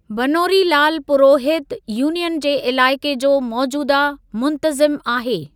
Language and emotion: Sindhi, neutral